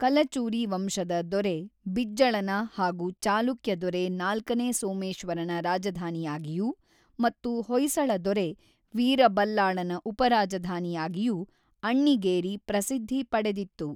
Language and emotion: Kannada, neutral